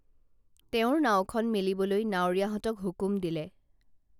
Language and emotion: Assamese, neutral